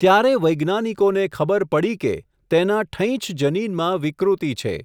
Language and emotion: Gujarati, neutral